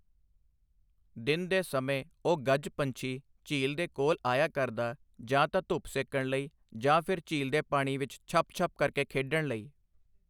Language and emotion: Punjabi, neutral